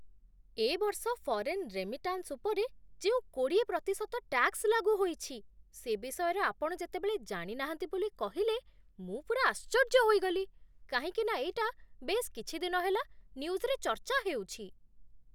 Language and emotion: Odia, surprised